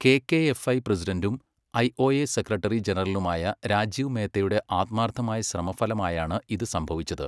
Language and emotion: Malayalam, neutral